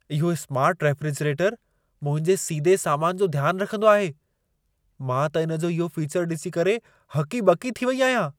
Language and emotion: Sindhi, surprised